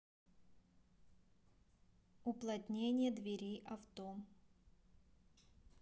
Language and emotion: Russian, neutral